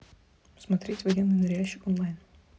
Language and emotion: Russian, neutral